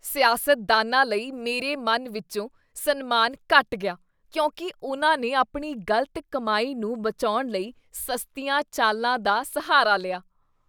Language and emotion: Punjabi, disgusted